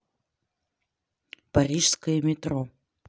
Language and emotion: Russian, neutral